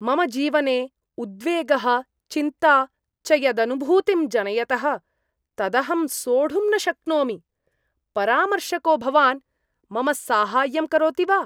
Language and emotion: Sanskrit, disgusted